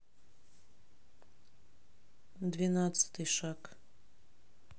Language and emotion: Russian, neutral